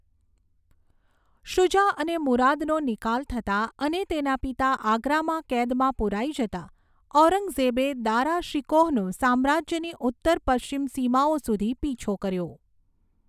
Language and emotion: Gujarati, neutral